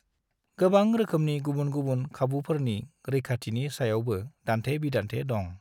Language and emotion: Bodo, neutral